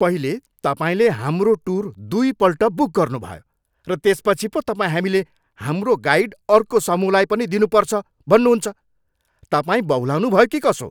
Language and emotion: Nepali, angry